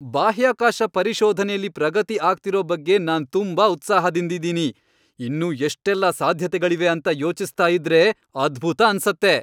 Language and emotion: Kannada, happy